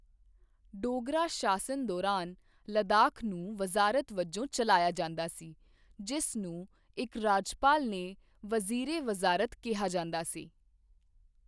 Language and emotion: Punjabi, neutral